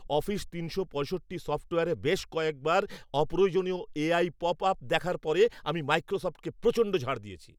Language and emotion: Bengali, angry